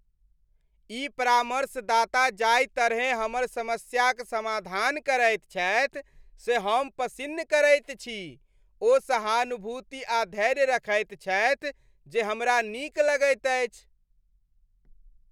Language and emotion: Maithili, happy